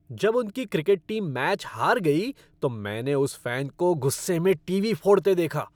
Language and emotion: Hindi, angry